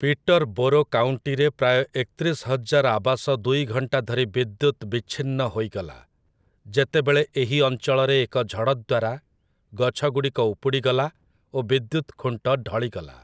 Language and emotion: Odia, neutral